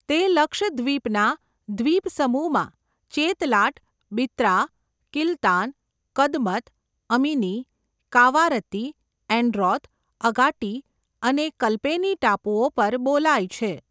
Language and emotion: Gujarati, neutral